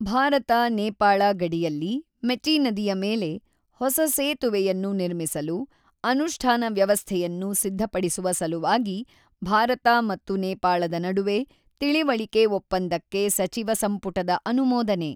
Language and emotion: Kannada, neutral